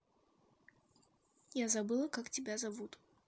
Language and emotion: Russian, neutral